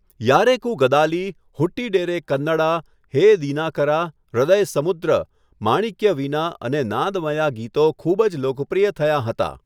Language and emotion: Gujarati, neutral